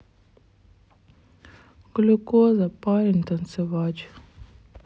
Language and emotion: Russian, sad